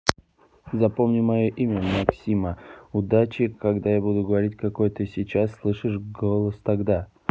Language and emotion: Russian, neutral